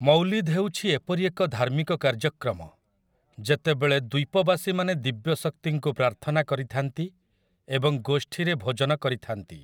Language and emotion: Odia, neutral